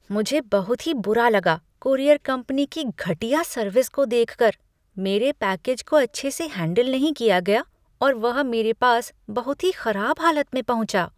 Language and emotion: Hindi, disgusted